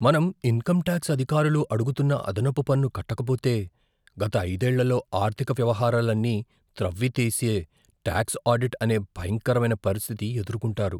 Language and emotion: Telugu, fearful